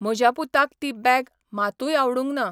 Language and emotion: Goan Konkani, neutral